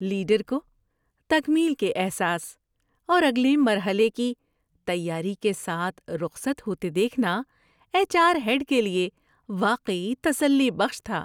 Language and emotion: Urdu, happy